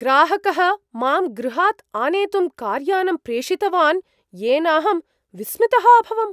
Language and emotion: Sanskrit, surprised